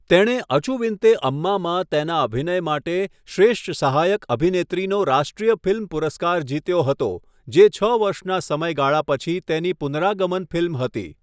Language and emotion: Gujarati, neutral